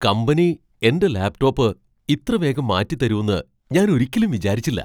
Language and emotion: Malayalam, surprised